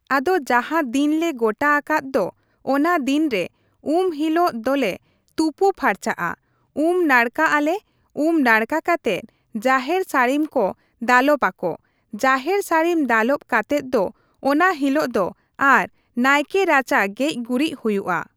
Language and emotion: Santali, neutral